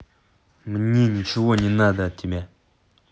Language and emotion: Russian, angry